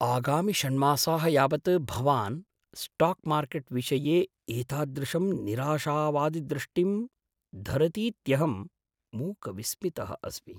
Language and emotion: Sanskrit, surprised